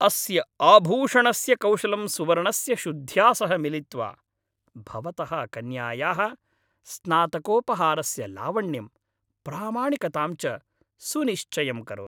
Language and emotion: Sanskrit, happy